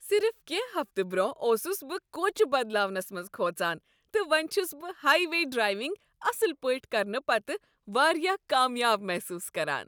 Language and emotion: Kashmiri, happy